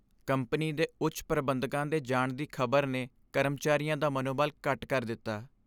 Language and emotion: Punjabi, sad